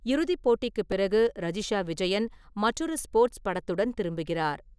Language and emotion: Tamil, neutral